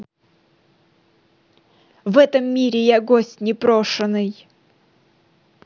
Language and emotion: Russian, neutral